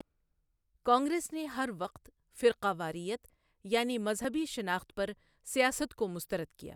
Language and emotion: Urdu, neutral